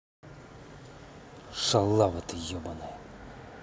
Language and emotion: Russian, angry